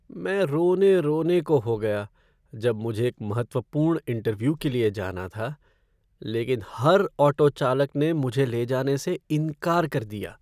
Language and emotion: Hindi, sad